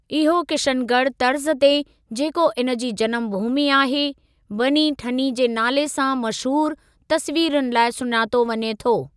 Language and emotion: Sindhi, neutral